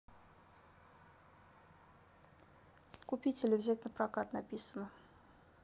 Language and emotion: Russian, neutral